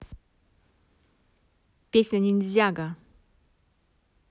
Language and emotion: Russian, positive